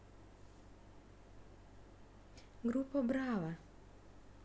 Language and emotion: Russian, neutral